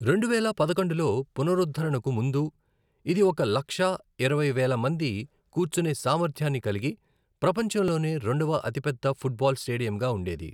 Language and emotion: Telugu, neutral